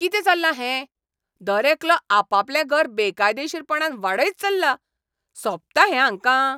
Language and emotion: Goan Konkani, angry